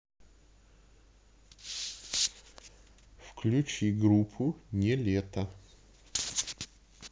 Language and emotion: Russian, neutral